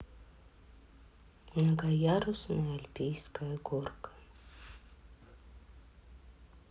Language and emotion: Russian, sad